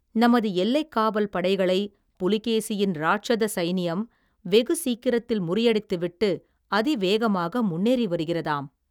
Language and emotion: Tamil, neutral